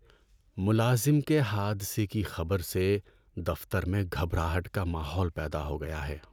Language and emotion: Urdu, sad